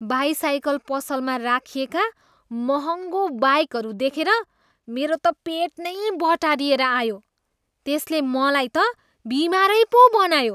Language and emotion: Nepali, disgusted